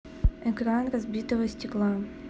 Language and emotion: Russian, neutral